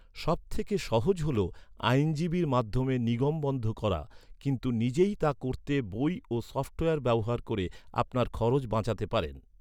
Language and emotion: Bengali, neutral